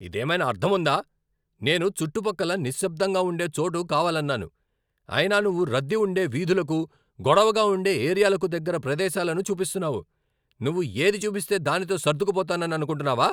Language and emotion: Telugu, angry